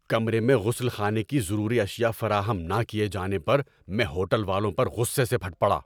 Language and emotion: Urdu, angry